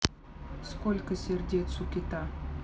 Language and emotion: Russian, neutral